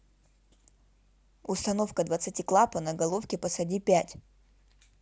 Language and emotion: Russian, neutral